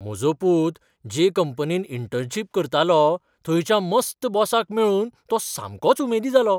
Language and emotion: Goan Konkani, surprised